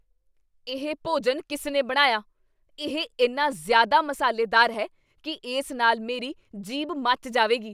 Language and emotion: Punjabi, angry